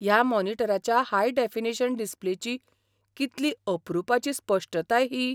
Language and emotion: Goan Konkani, surprised